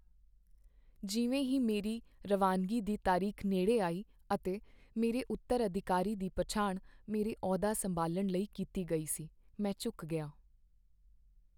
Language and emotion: Punjabi, sad